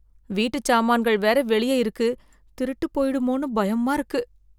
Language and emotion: Tamil, fearful